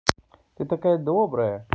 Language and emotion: Russian, positive